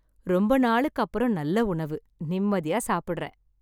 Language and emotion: Tamil, happy